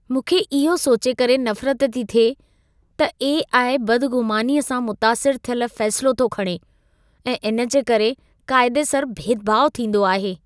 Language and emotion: Sindhi, disgusted